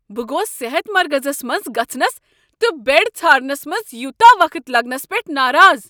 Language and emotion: Kashmiri, angry